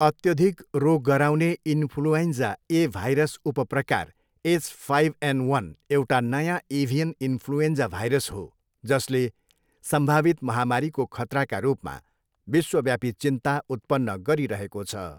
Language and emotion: Nepali, neutral